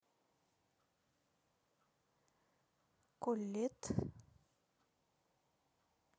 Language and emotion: Russian, neutral